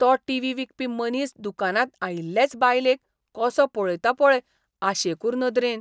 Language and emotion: Goan Konkani, disgusted